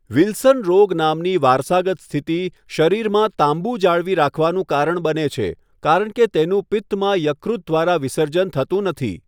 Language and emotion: Gujarati, neutral